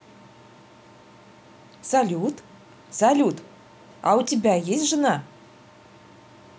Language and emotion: Russian, positive